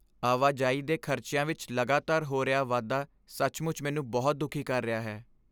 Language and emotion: Punjabi, sad